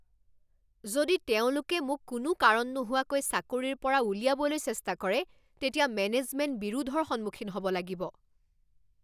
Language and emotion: Assamese, angry